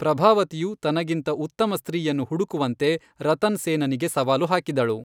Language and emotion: Kannada, neutral